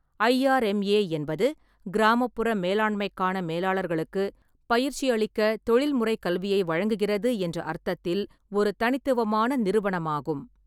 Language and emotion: Tamil, neutral